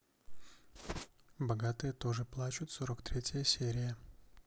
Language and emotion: Russian, neutral